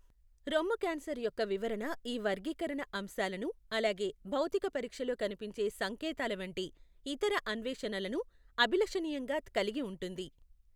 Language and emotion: Telugu, neutral